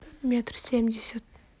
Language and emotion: Russian, neutral